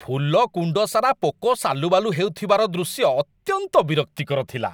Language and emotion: Odia, disgusted